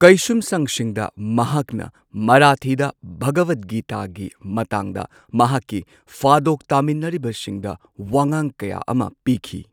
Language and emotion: Manipuri, neutral